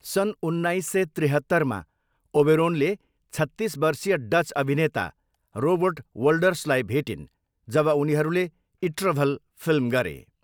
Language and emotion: Nepali, neutral